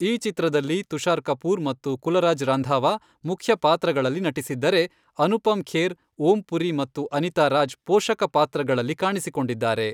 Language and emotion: Kannada, neutral